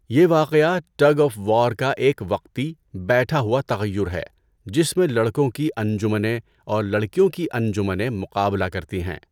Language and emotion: Urdu, neutral